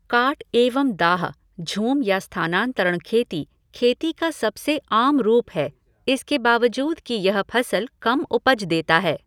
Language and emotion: Hindi, neutral